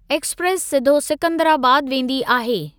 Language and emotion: Sindhi, neutral